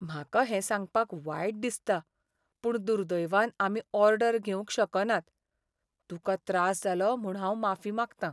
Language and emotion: Goan Konkani, sad